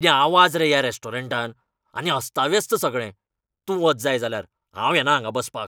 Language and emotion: Goan Konkani, angry